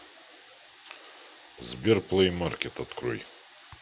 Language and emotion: Russian, neutral